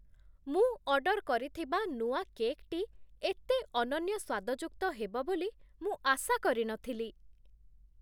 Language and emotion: Odia, surprised